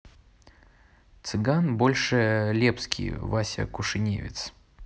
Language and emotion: Russian, neutral